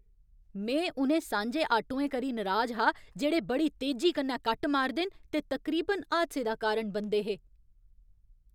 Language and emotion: Dogri, angry